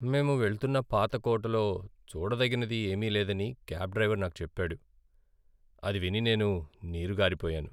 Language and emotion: Telugu, sad